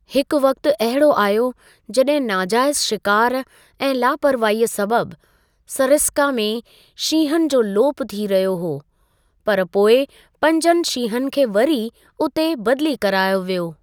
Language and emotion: Sindhi, neutral